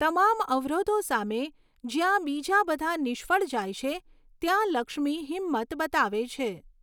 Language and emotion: Gujarati, neutral